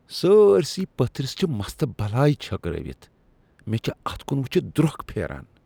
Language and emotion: Kashmiri, disgusted